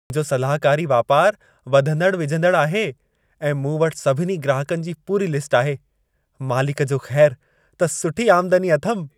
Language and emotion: Sindhi, happy